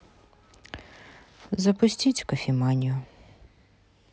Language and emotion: Russian, neutral